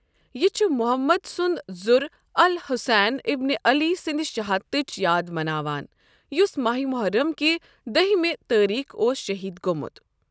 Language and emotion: Kashmiri, neutral